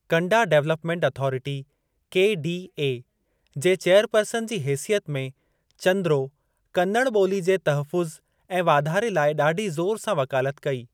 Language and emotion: Sindhi, neutral